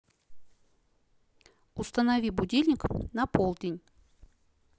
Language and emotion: Russian, neutral